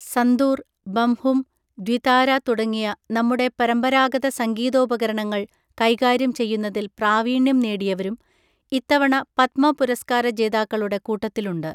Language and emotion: Malayalam, neutral